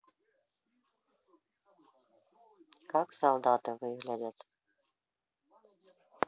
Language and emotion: Russian, neutral